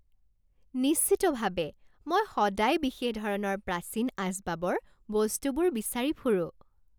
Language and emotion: Assamese, happy